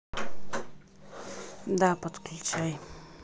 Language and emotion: Russian, neutral